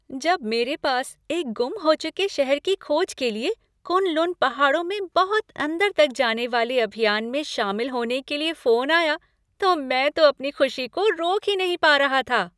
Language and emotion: Hindi, happy